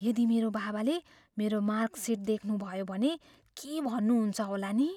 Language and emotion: Nepali, fearful